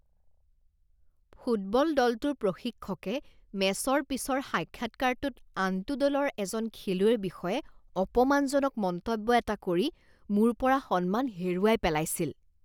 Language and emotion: Assamese, disgusted